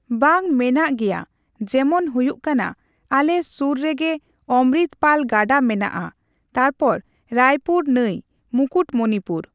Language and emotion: Santali, neutral